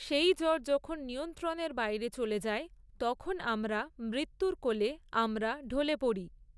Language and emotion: Bengali, neutral